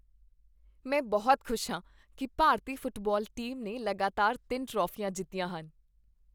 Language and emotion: Punjabi, happy